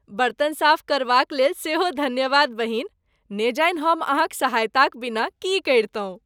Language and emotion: Maithili, happy